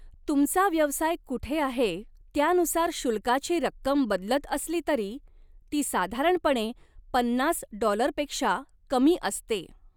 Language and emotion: Marathi, neutral